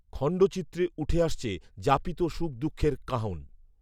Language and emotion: Bengali, neutral